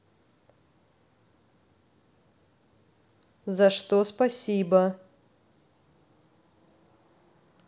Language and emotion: Russian, neutral